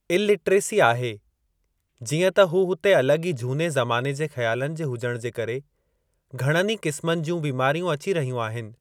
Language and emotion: Sindhi, neutral